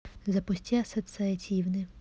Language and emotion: Russian, neutral